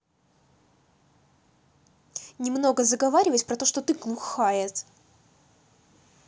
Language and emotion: Russian, angry